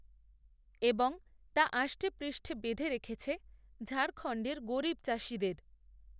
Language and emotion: Bengali, neutral